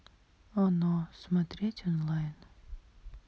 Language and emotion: Russian, sad